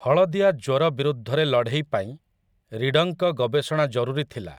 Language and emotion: Odia, neutral